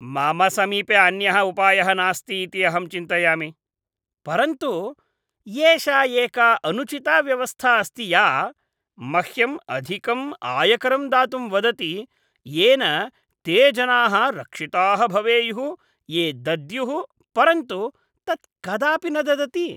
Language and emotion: Sanskrit, disgusted